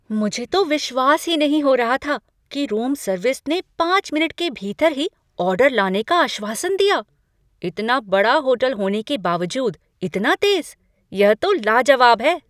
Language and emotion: Hindi, surprised